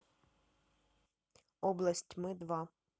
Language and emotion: Russian, neutral